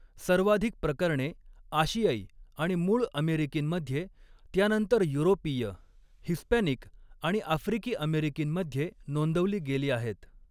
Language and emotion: Marathi, neutral